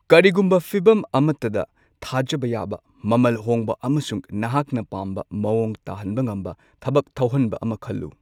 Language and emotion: Manipuri, neutral